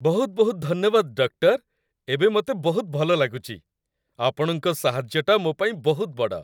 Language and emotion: Odia, happy